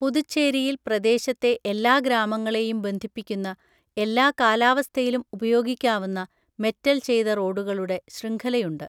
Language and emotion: Malayalam, neutral